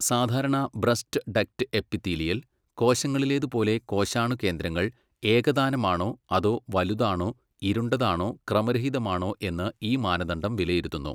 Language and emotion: Malayalam, neutral